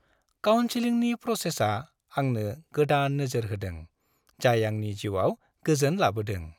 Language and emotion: Bodo, happy